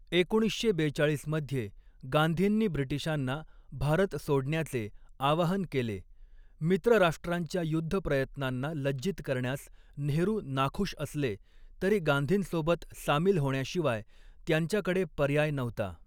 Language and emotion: Marathi, neutral